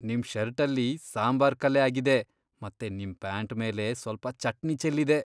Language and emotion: Kannada, disgusted